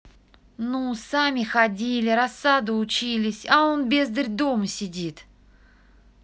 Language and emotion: Russian, angry